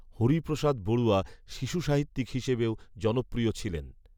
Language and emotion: Bengali, neutral